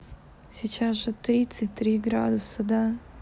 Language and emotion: Russian, sad